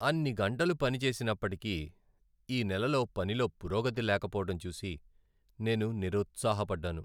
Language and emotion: Telugu, sad